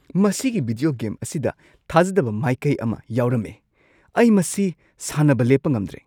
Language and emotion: Manipuri, surprised